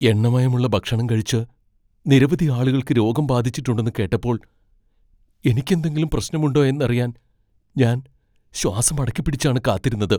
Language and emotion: Malayalam, fearful